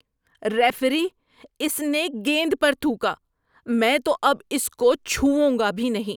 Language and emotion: Urdu, disgusted